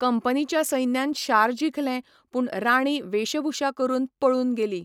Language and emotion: Goan Konkani, neutral